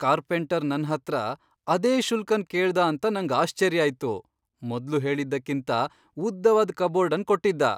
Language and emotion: Kannada, surprised